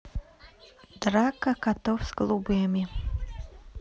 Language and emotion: Russian, neutral